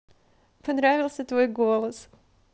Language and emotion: Russian, positive